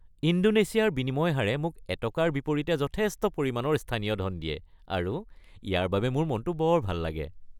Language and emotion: Assamese, happy